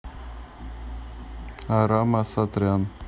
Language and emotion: Russian, neutral